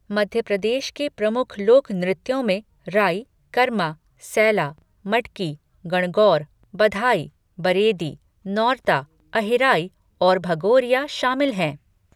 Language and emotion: Hindi, neutral